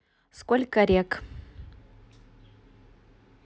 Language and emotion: Russian, neutral